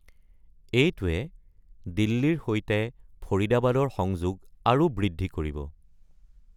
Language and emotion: Assamese, neutral